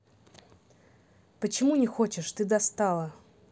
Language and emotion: Russian, neutral